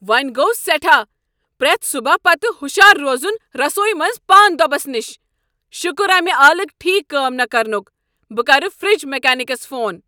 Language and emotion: Kashmiri, angry